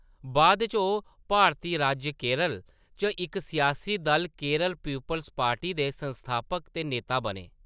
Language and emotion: Dogri, neutral